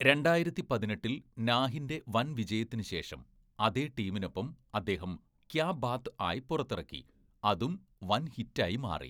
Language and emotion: Malayalam, neutral